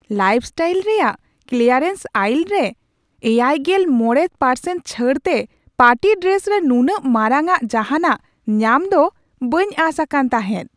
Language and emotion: Santali, surprised